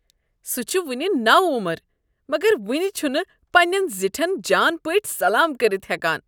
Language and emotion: Kashmiri, disgusted